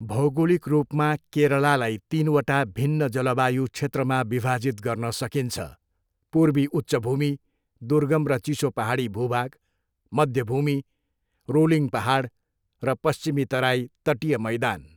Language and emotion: Nepali, neutral